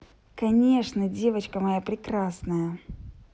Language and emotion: Russian, positive